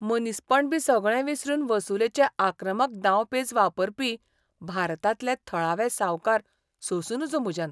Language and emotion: Goan Konkani, disgusted